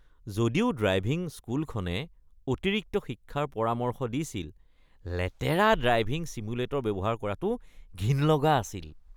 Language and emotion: Assamese, disgusted